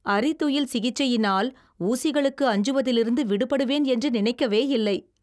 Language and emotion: Tamil, surprised